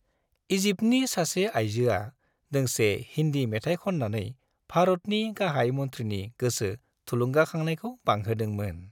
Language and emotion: Bodo, happy